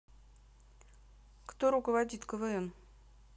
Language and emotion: Russian, neutral